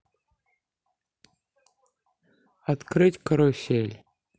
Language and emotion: Russian, neutral